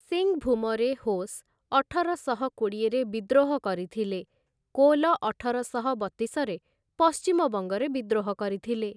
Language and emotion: Odia, neutral